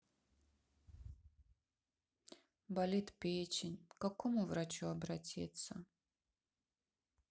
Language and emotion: Russian, sad